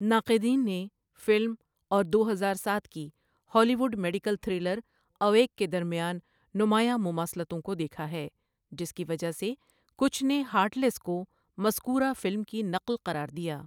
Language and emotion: Urdu, neutral